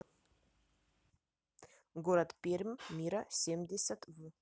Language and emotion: Russian, neutral